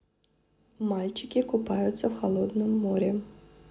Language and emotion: Russian, neutral